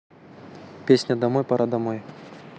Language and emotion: Russian, neutral